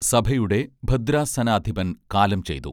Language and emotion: Malayalam, neutral